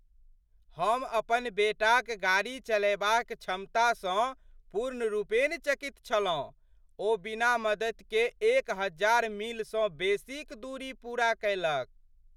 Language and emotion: Maithili, surprised